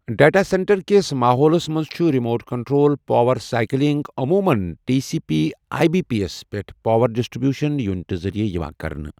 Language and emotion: Kashmiri, neutral